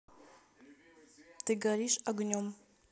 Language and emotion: Russian, neutral